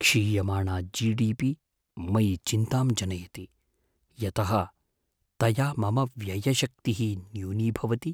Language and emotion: Sanskrit, fearful